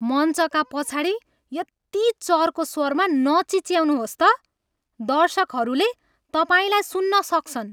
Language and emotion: Nepali, angry